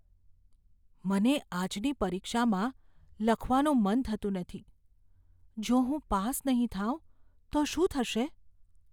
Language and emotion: Gujarati, fearful